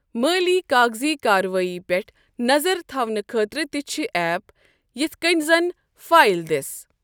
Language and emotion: Kashmiri, neutral